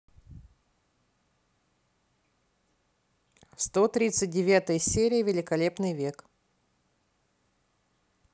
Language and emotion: Russian, positive